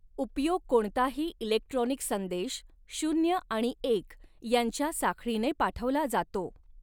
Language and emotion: Marathi, neutral